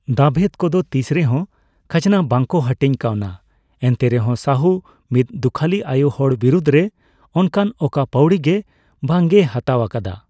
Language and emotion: Santali, neutral